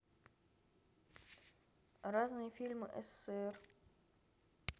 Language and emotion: Russian, neutral